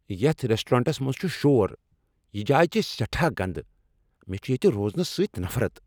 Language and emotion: Kashmiri, angry